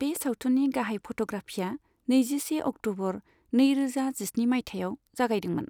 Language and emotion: Bodo, neutral